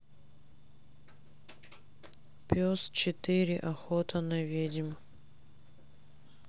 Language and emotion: Russian, sad